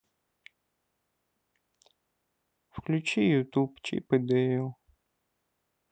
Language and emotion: Russian, sad